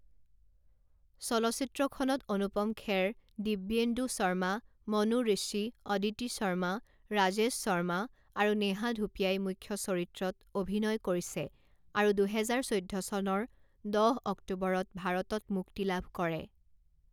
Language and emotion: Assamese, neutral